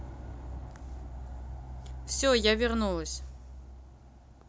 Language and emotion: Russian, neutral